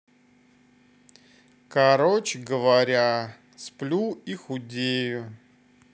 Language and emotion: Russian, neutral